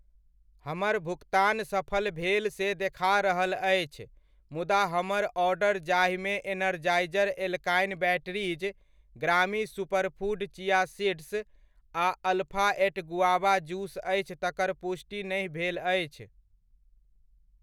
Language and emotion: Maithili, neutral